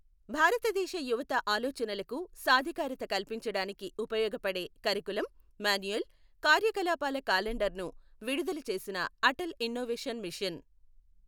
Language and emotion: Telugu, neutral